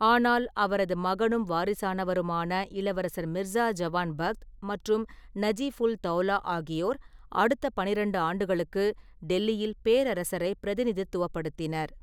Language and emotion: Tamil, neutral